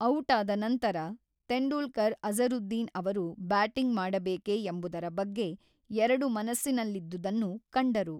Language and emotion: Kannada, neutral